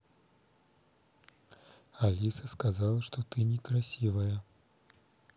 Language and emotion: Russian, neutral